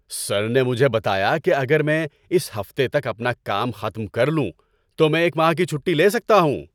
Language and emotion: Urdu, happy